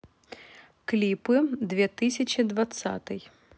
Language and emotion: Russian, neutral